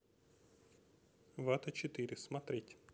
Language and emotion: Russian, neutral